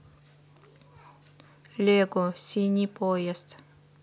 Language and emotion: Russian, neutral